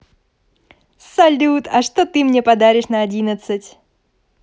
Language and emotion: Russian, positive